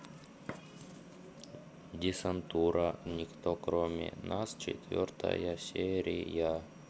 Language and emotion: Russian, neutral